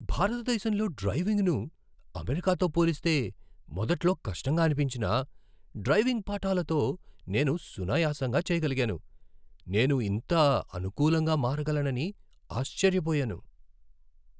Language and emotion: Telugu, surprised